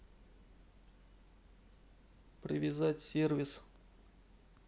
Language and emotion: Russian, neutral